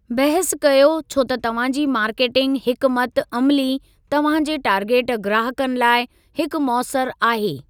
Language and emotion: Sindhi, neutral